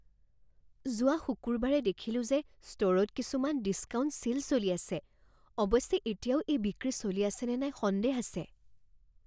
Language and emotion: Assamese, fearful